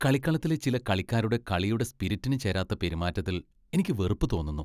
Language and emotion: Malayalam, disgusted